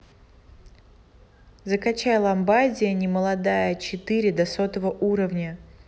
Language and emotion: Russian, neutral